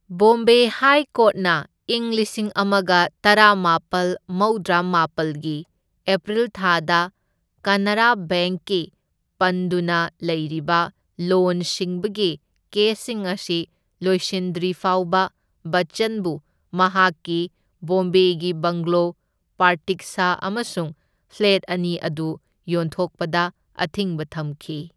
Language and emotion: Manipuri, neutral